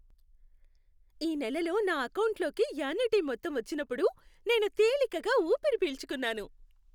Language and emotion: Telugu, happy